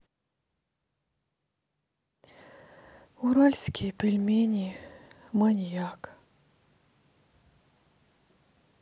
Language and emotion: Russian, sad